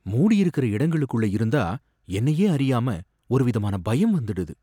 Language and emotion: Tamil, fearful